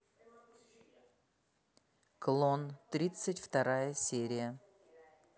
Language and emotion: Russian, neutral